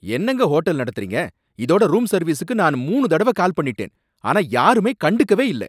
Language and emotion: Tamil, angry